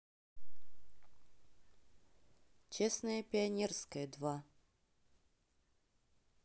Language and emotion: Russian, neutral